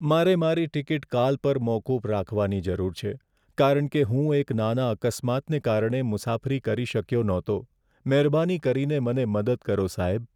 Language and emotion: Gujarati, sad